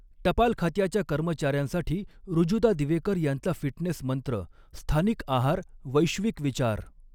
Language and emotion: Marathi, neutral